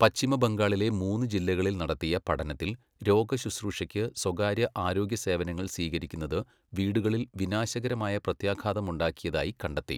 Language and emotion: Malayalam, neutral